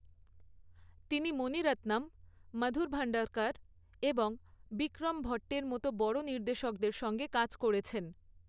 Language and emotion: Bengali, neutral